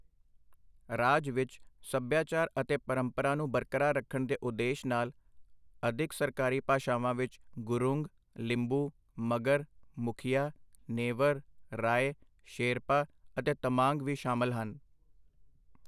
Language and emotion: Punjabi, neutral